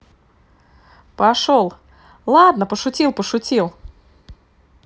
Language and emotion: Russian, positive